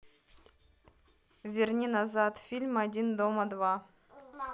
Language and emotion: Russian, neutral